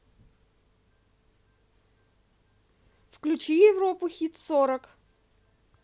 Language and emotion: Russian, positive